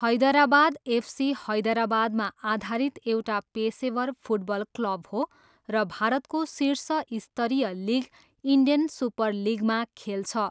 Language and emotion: Nepali, neutral